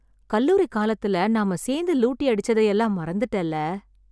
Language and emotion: Tamil, sad